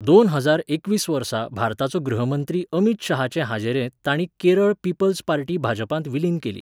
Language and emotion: Goan Konkani, neutral